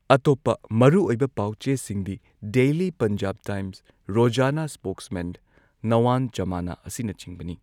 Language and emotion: Manipuri, neutral